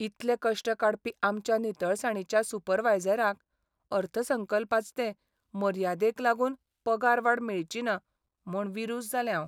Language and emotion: Goan Konkani, sad